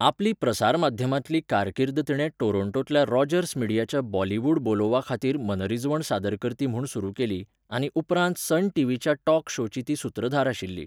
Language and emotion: Goan Konkani, neutral